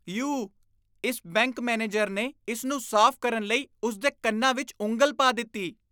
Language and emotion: Punjabi, disgusted